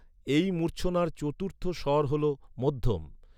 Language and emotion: Bengali, neutral